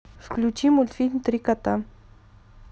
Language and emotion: Russian, neutral